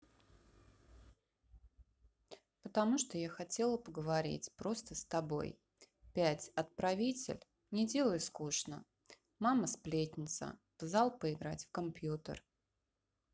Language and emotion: Russian, neutral